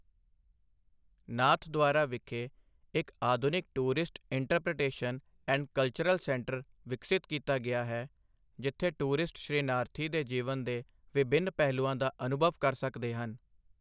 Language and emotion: Punjabi, neutral